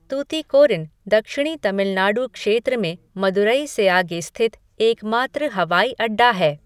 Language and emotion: Hindi, neutral